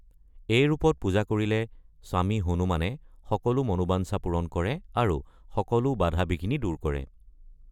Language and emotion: Assamese, neutral